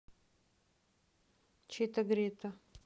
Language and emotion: Russian, neutral